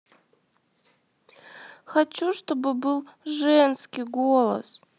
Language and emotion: Russian, sad